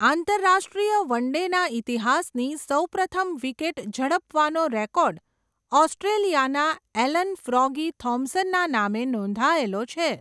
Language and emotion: Gujarati, neutral